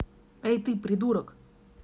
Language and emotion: Russian, angry